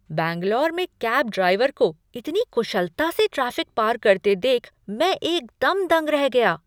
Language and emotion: Hindi, surprised